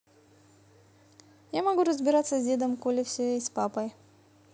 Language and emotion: Russian, neutral